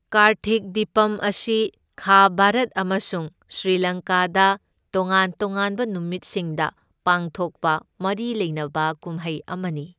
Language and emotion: Manipuri, neutral